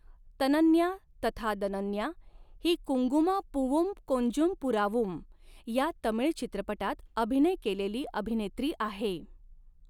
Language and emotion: Marathi, neutral